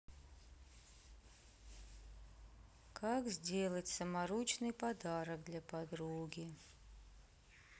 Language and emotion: Russian, neutral